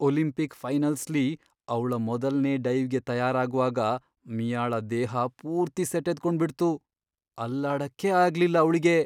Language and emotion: Kannada, fearful